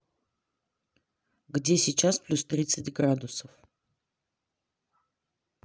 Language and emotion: Russian, neutral